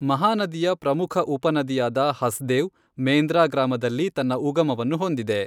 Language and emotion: Kannada, neutral